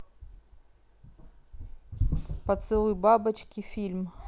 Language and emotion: Russian, neutral